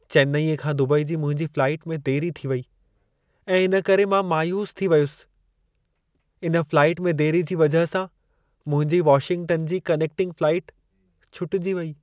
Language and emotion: Sindhi, sad